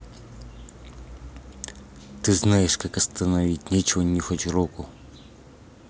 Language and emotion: Russian, angry